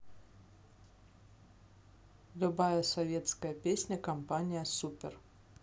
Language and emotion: Russian, neutral